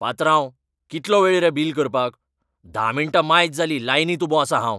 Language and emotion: Goan Konkani, angry